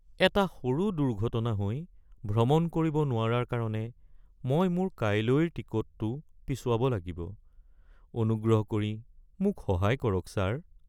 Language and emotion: Assamese, sad